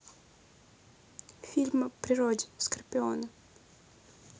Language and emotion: Russian, neutral